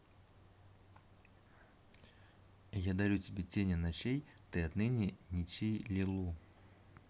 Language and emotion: Russian, neutral